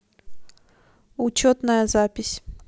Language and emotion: Russian, neutral